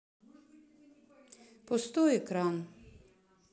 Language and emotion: Russian, neutral